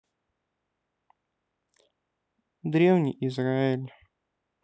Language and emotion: Russian, neutral